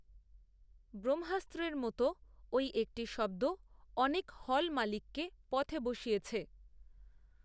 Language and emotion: Bengali, neutral